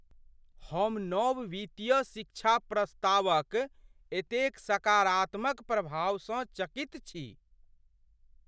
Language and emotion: Maithili, surprised